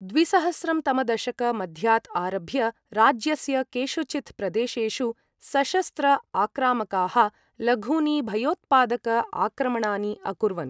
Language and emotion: Sanskrit, neutral